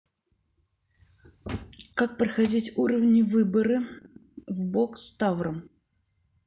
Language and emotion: Russian, neutral